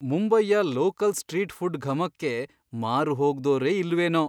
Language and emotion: Kannada, surprised